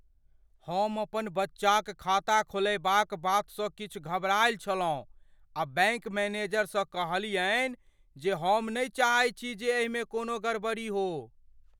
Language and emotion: Maithili, fearful